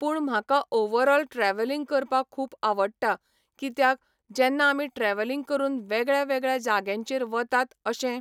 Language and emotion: Goan Konkani, neutral